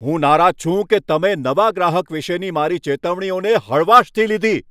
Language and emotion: Gujarati, angry